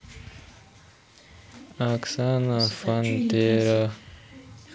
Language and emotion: Russian, neutral